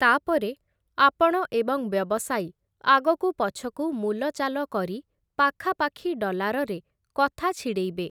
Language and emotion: Odia, neutral